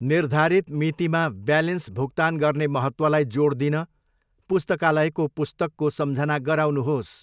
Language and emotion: Nepali, neutral